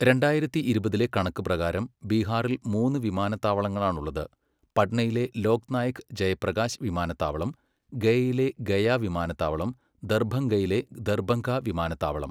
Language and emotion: Malayalam, neutral